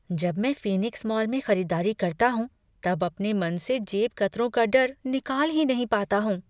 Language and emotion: Hindi, fearful